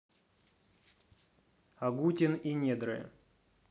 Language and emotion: Russian, neutral